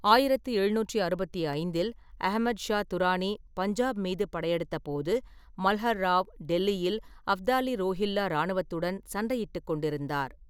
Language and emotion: Tamil, neutral